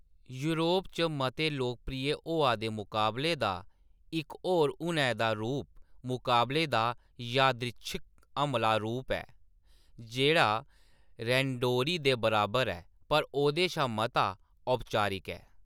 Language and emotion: Dogri, neutral